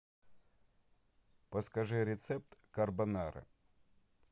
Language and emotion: Russian, neutral